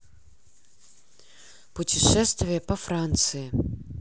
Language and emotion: Russian, neutral